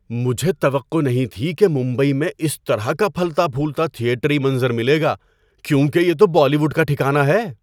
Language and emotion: Urdu, surprised